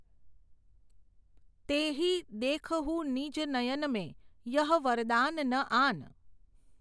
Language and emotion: Gujarati, neutral